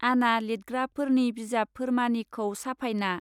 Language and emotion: Bodo, neutral